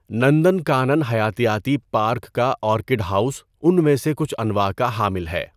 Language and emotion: Urdu, neutral